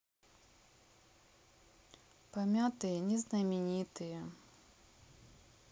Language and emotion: Russian, sad